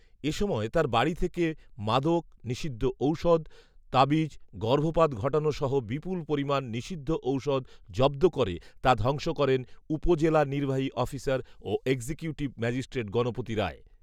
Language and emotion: Bengali, neutral